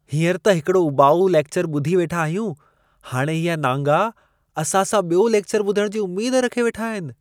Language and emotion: Sindhi, disgusted